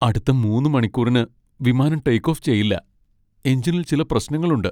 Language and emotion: Malayalam, sad